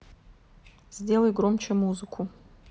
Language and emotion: Russian, neutral